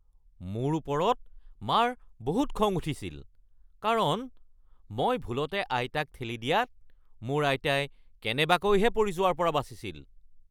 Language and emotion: Assamese, angry